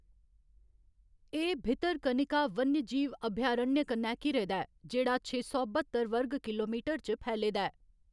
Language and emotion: Dogri, neutral